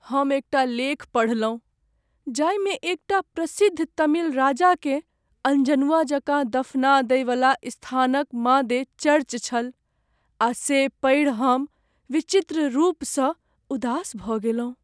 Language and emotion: Maithili, sad